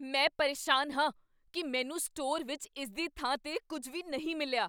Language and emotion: Punjabi, angry